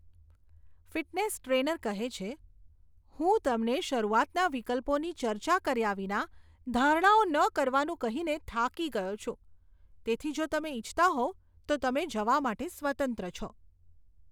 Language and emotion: Gujarati, disgusted